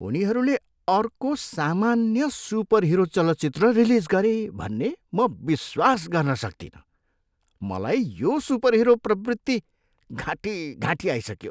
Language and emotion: Nepali, disgusted